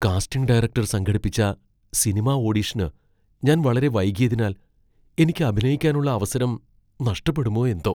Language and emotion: Malayalam, fearful